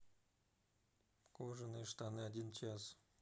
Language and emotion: Russian, neutral